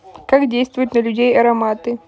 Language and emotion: Russian, neutral